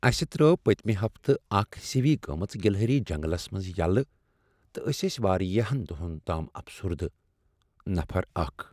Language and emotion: Kashmiri, sad